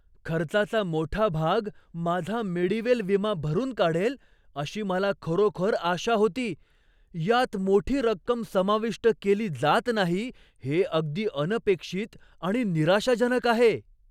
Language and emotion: Marathi, surprised